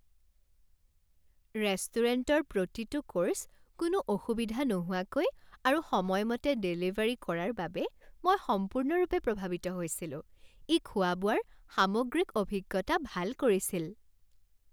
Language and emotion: Assamese, happy